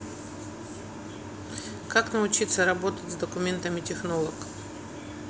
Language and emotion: Russian, neutral